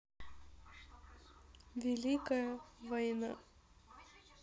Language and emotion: Russian, sad